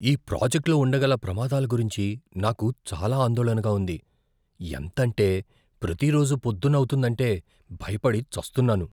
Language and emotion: Telugu, fearful